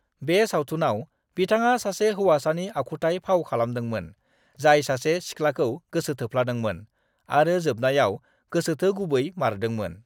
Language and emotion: Bodo, neutral